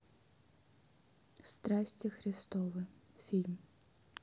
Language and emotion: Russian, neutral